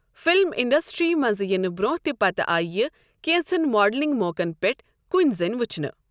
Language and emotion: Kashmiri, neutral